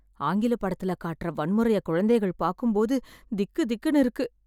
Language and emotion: Tamil, fearful